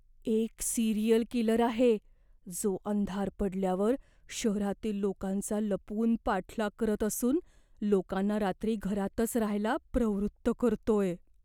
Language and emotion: Marathi, fearful